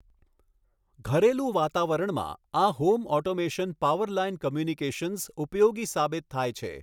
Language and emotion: Gujarati, neutral